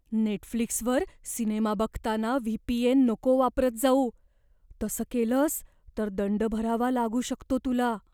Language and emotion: Marathi, fearful